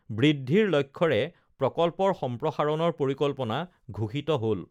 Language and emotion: Assamese, neutral